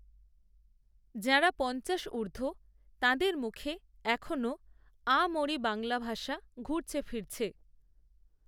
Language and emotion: Bengali, neutral